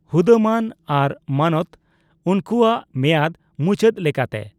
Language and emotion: Santali, neutral